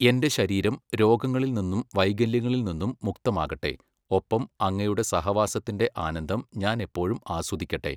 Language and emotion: Malayalam, neutral